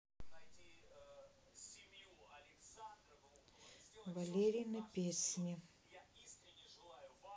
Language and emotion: Russian, neutral